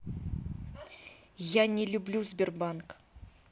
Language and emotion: Russian, angry